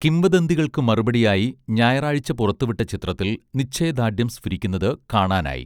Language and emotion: Malayalam, neutral